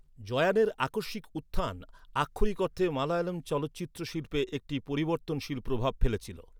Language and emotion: Bengali, neutral